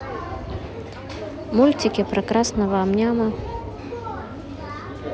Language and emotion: Russian, neutral